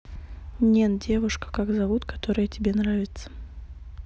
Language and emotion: Russian, neutral